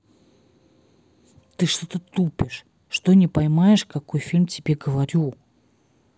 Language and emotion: Russian, angry